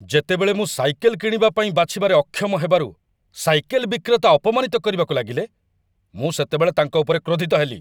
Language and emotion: Odia, angry